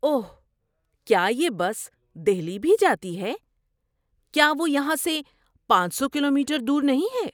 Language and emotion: Urdu, surprised